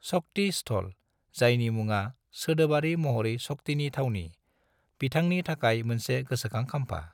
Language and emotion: Bodo, neutral